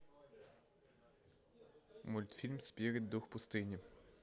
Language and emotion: Russian, neutral